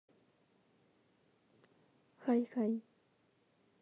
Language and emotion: Russian, neutral